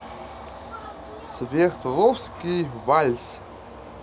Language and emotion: Russian, positive